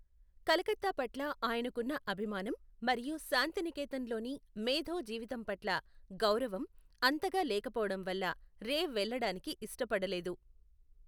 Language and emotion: Telugu, neutral